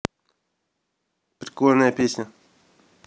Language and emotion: Russian, neutral